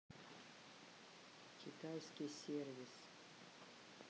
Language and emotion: Russian, neutral